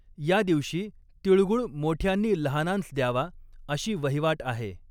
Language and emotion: Marathi, neutral